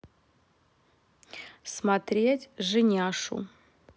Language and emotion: Russian, neutral